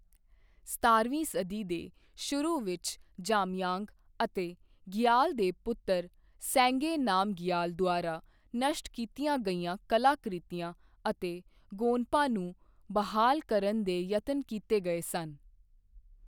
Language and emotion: Punjabi, neutral